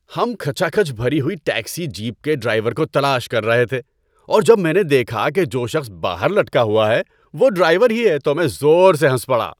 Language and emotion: Urdu, happy